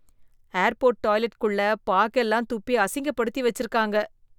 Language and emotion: Tamil, disgusted